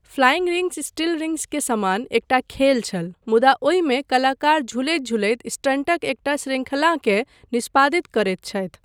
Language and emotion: Maithili, neutral